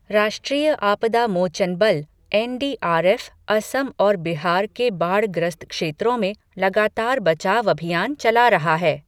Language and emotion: Hindi, neutral